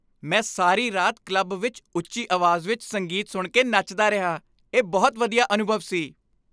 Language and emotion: Punjabi, happy